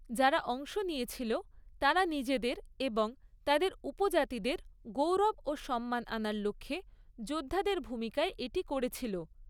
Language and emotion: Bengali, neutral